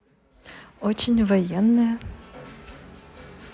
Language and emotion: Russian, positive